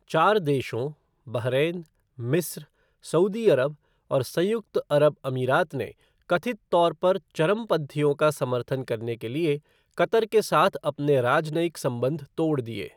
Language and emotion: Hindi, neutral